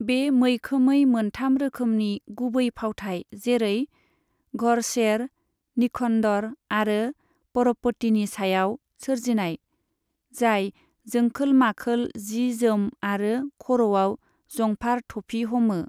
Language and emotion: Bodo, neutral